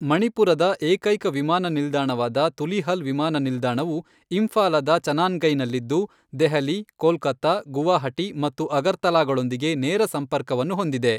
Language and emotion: Kannada, neutral